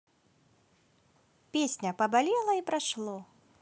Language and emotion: Russian, positive